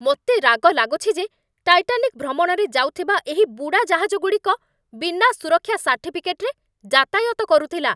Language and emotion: Odia, angry